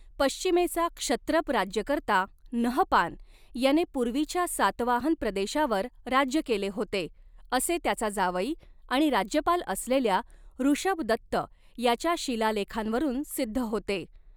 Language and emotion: Marathi, neutral